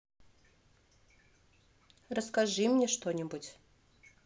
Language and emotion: Russian, neutral